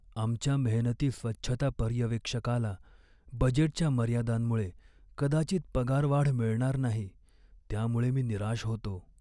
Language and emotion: Marathi, sad